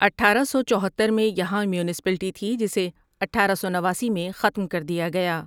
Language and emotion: Urdu, neutral